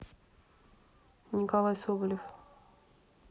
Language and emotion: Russian, neutral